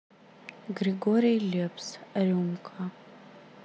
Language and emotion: Russian, neutral